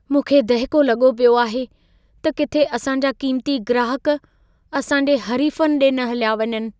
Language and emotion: Sindhi, fearful